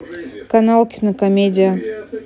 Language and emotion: Russian, neutral